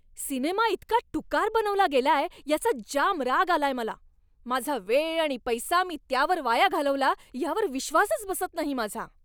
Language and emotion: Marathi, angry